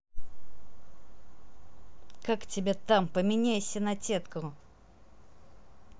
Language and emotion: Russian, angry